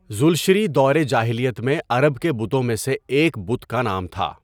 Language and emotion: Urdu, neutral